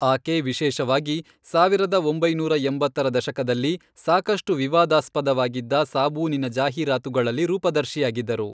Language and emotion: Kannada, neutral